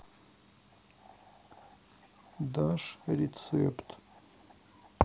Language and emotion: Russian, sad